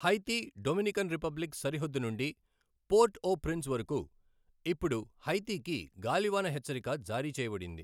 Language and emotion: Telugu, neutral